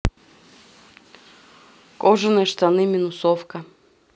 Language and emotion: Russian, neutral